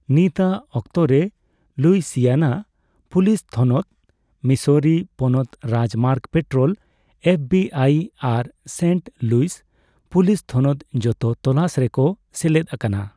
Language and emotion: Santali, neutral